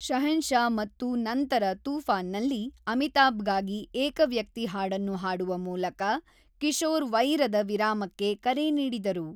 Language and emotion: Kannada, neutral